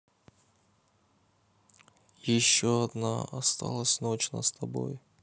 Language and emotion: Russian, neutral